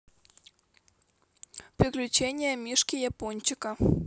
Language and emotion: Russian, neutral